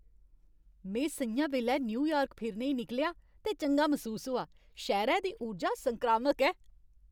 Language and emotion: Dogri, happy